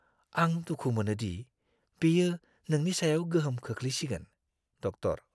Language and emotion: Bodo, fearful